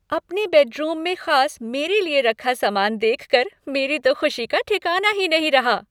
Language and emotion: Hindi, happy